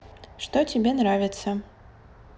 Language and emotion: Russian, neutral